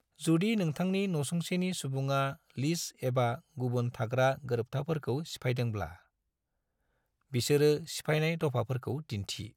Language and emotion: Bodo, neutral